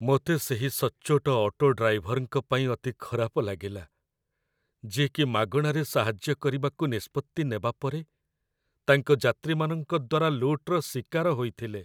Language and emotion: Odia, sad